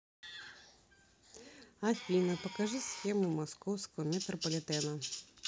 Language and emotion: Russian, neutral